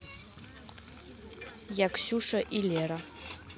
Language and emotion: Russian, neutral